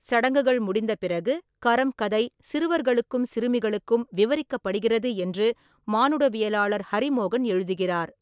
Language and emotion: Tamil, neutral